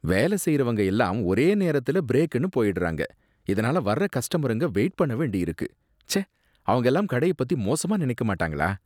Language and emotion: Tamil, disgusted